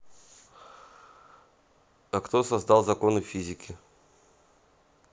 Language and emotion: Russian, neutral